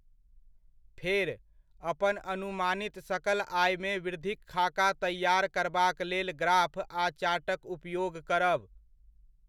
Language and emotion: Maithili, neutral